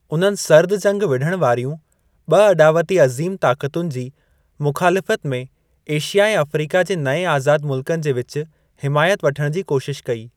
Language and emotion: Sindhi, neutral